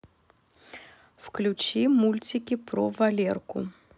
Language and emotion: Russian, neutral